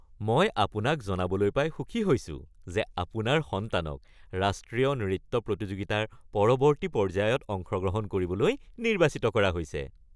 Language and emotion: Assamese, happy